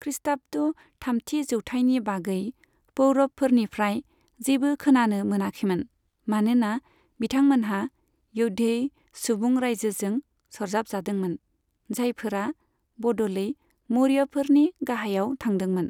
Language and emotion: Bodo, neutral